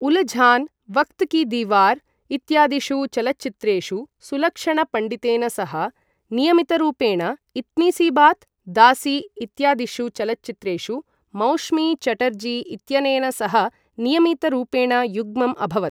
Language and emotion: Sanskrit, neutral